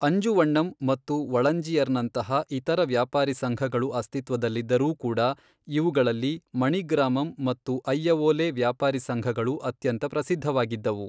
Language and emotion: Kannada, neutral